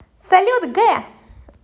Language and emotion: Russian, positive